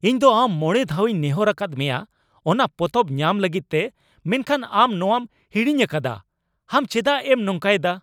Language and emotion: Santali, angry